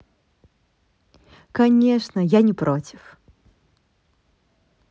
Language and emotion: Russian, positive